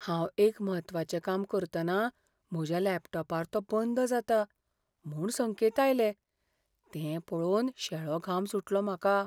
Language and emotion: Goan Konkani, fearful